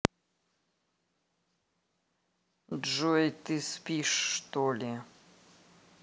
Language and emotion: Russian, neutral